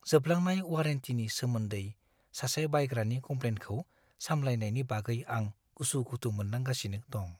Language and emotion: Bodo, fearful